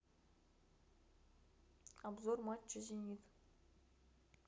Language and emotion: Russian, neutral